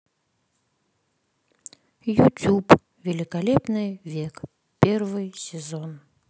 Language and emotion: Russian, sad